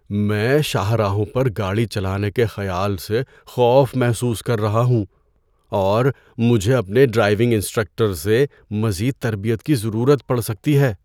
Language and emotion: Urdu, fearful